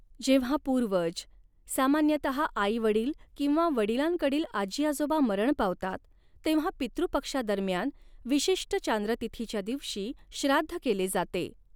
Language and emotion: Marathi, neutral